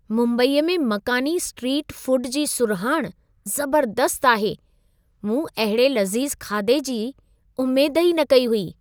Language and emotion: Sindhi, surprised